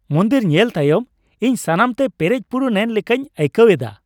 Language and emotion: Santali, happy